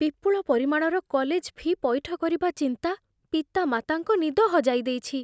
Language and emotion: Odia, fearful